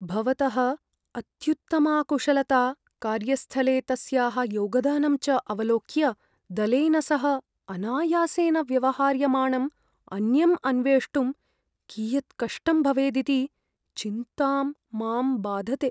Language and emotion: Sanskrit, fearful